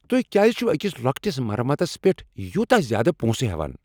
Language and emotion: Kashmiri, angry